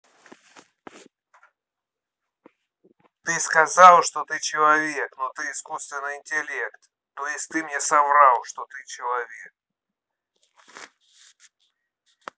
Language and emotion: Russian, angry